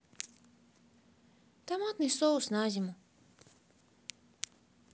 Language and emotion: Russian, sad